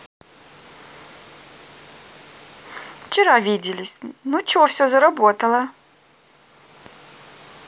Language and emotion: Russian, positive